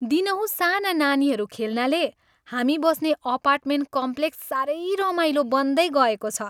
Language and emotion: Nepali, happy